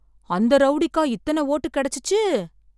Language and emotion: Tamil, surprised